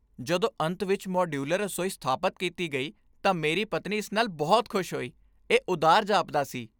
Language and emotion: Punjabi, happy